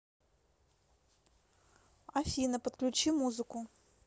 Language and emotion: Russian, neutral